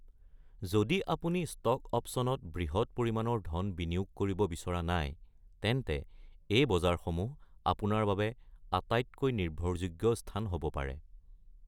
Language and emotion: Assamese, neutral